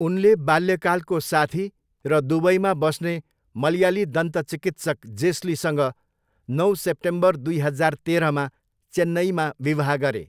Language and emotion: Nepali, neutral